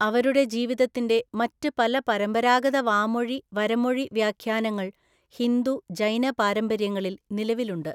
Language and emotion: Malayalam, neutral